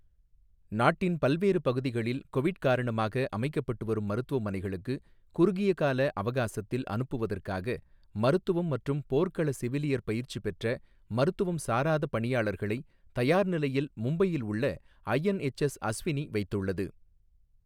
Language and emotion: Tamil, neutral